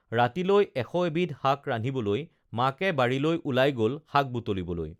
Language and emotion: Assamese, neutral